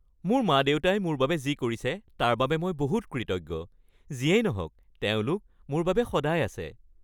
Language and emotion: Assamese, happy